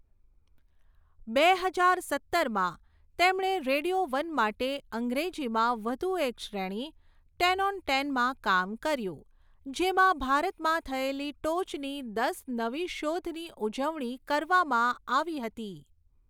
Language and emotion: Gujarati, neutral